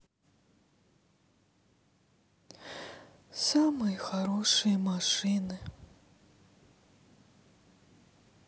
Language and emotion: Russian, sad